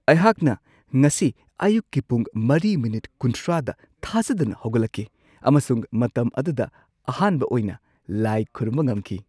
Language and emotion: Manipuri, surprised